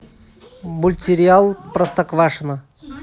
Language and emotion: Russian, neutral